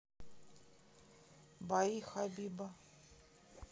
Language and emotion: Russian, neutral